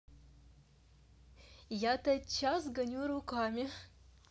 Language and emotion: Russian, positive